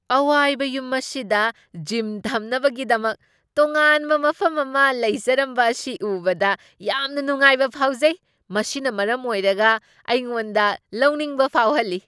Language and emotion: Manipuri, surprised